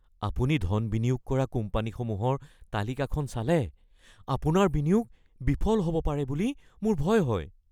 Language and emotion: Assamese, fearful